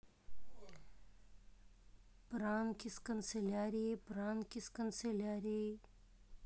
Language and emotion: Russian, neutral